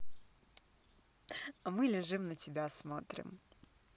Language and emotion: Russian, positive